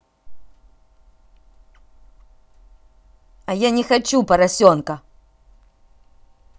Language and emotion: Russian, angry